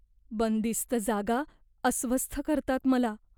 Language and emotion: Marathi, fearful